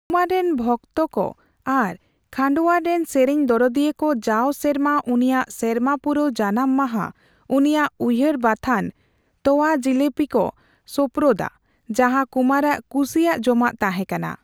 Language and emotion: Santali, neutral